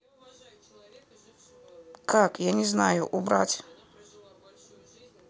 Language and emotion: Russian, neutral